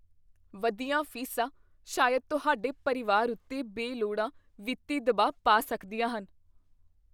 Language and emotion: Punjabi, fearful